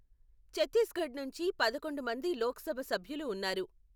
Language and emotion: Telugu, neutral